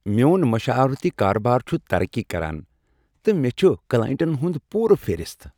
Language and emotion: Kashmiri, happy